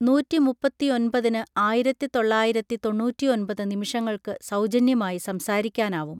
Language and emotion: Malayalam, neutral